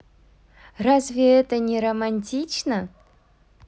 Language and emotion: Russian, positive